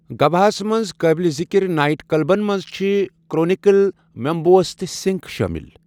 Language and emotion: Kashmiri, neutral